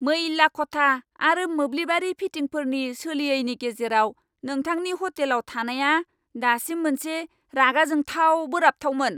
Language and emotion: Bodo, angry